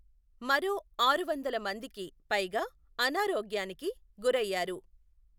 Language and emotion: Telugu, neutral